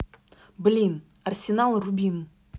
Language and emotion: Russian, angry